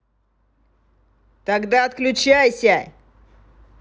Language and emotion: Russian, angry